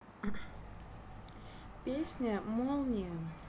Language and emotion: Russian, neutral